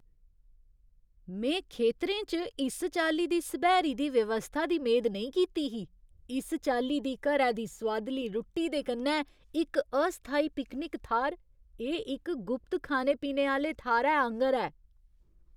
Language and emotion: Dogri, surprised